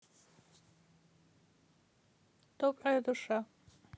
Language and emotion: Russian, neutral